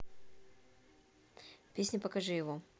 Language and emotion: Russian, neutral